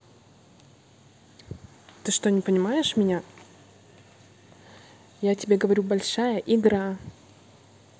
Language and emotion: Russian, angry